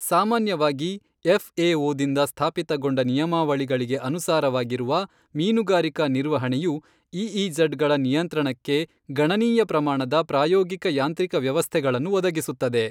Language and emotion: Kannada, neutral